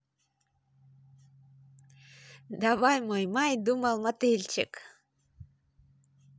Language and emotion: Russian, positive